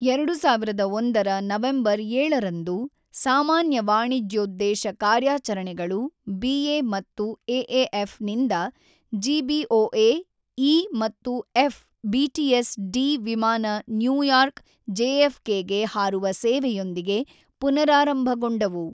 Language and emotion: Kannada, neutral